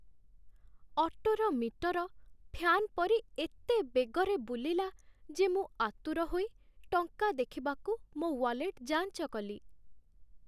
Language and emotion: Odia, sad